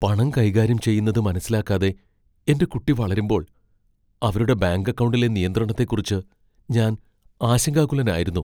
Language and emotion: Malayalam, fearful